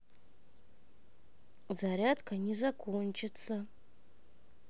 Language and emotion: Russian, neutral